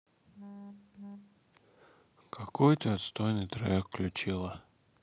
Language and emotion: Russian, sad